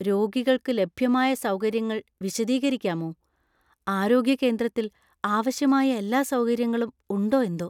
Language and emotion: Malayalam, fearful